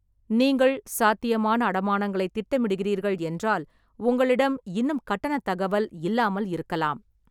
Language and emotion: Tamil, neutral